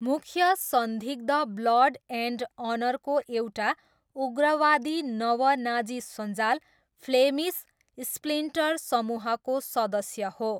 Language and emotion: Nepali, neutral